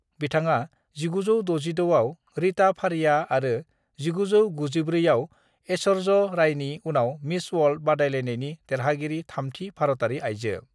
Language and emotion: Bodo, neutral